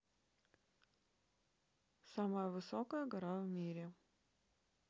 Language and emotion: Russian, neutral